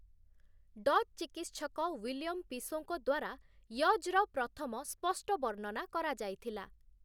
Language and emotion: Odia, neutral